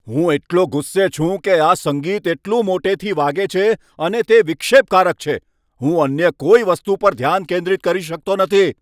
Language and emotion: Gujarati, angry